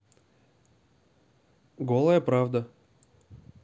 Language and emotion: Russian, neutral